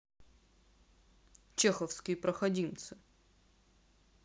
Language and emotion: Russian, angry